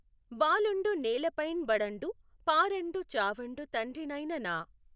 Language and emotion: Telugu, neutral